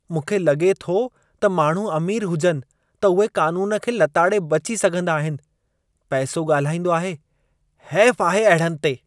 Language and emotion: Sindhi, disgusted